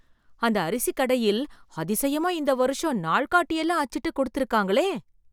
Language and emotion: Tamil, surprised